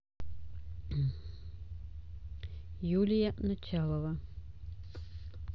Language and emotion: Russian, neutral